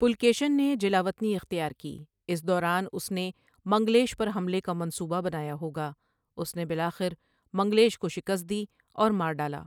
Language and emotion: Urdu, neutral